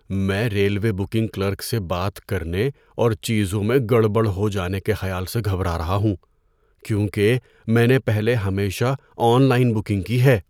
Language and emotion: Urdu, fearful